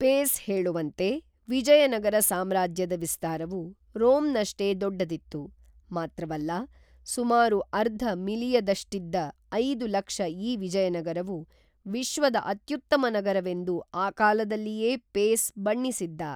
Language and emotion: Kannada, neutral